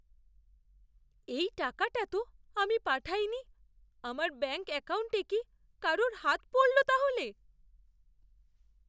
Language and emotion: Bengali, fearful